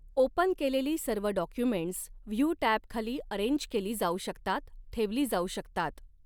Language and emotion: Marathi, neutral